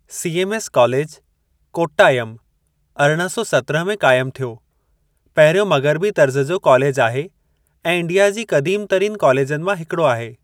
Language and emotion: Sindhi, neutral